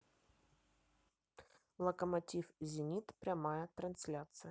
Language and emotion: Russian, neutral